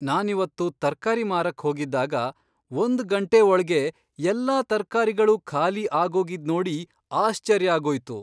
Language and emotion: Kannada, surprised